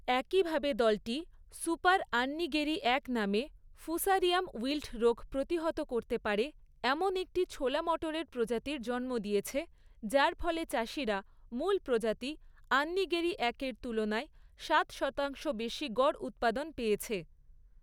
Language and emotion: Bengali, neutral